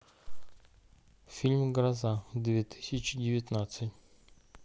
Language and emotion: Russian, neutral